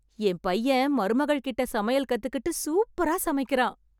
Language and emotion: Tamil, happy